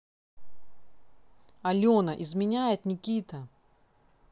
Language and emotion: Russian, angry